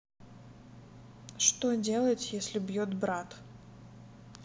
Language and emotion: Russian, neutral